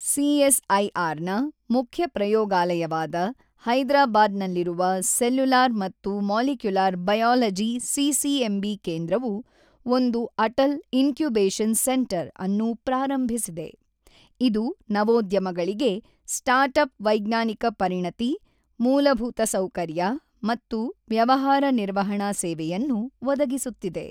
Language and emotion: Kannada, neutral